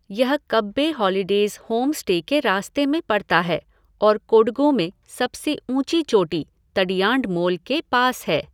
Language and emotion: Hindi, neutral